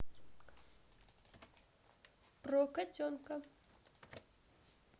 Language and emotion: Russian, neutral